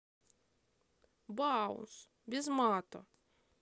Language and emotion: Russian, neutral